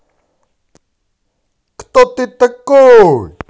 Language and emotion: Russian, positive